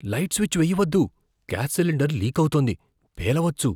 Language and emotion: Telugu, fearful